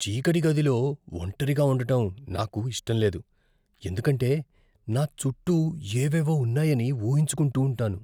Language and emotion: Telugu, fearful